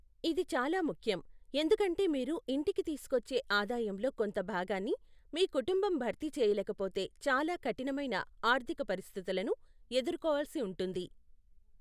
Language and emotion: Telugu, neutral